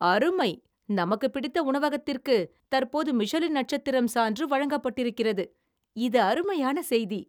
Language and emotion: Tamil, surprised